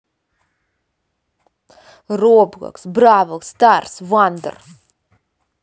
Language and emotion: Russian, angry